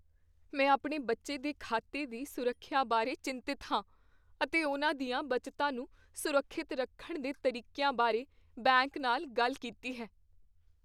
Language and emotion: Punjabi, fearful